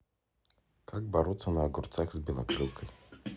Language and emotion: Russian, neutral